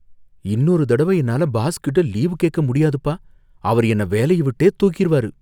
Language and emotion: Tamil, fearful